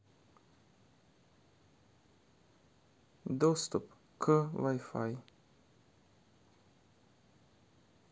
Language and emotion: Russian, sad